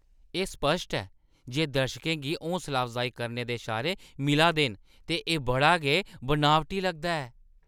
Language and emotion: Dogri, disgusted